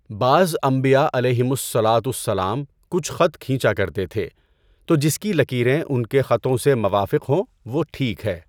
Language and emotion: Urdu, neutral